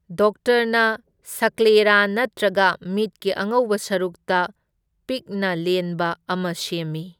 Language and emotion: Manipuri, neutral